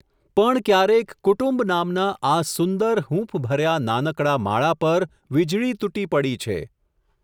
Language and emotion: Gujarati, neutral